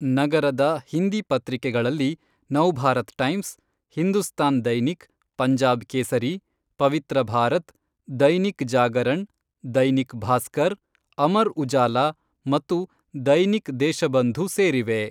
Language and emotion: Kannada, neutral